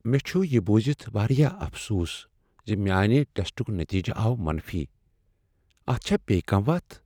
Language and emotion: Kashmiri, sad